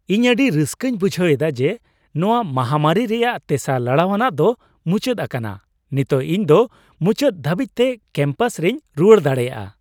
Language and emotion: Santali, happy